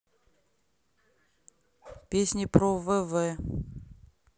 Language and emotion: Russian, neutral